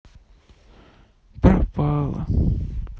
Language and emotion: Russian, sad